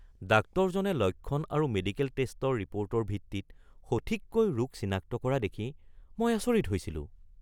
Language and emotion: Assamese, surprised